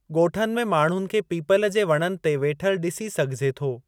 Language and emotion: Sindhi, neutral